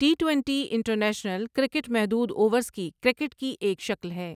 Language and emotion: Urdu, neutral